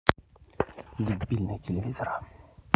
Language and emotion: Russian, angry